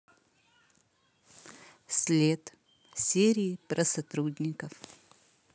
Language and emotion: Russian, neutral